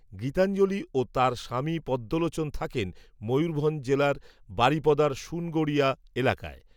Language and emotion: Bengali, neutral